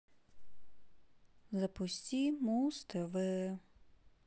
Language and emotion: Russian, sad